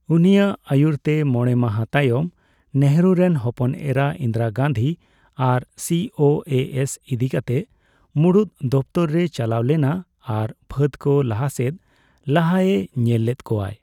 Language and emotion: Santali, neutral